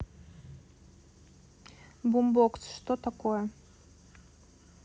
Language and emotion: Russian, neutral